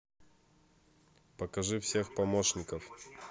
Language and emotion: Russian, neutral